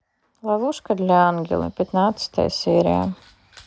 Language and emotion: Russian, neutral